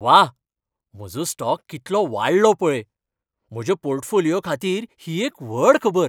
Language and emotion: Goan Konkani, happy